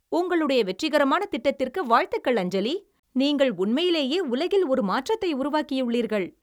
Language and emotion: Tamil, happy